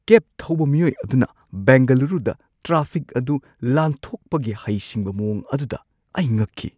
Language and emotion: Manipuri, surprised